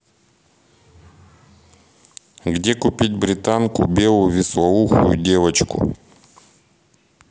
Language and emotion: Russian, neutral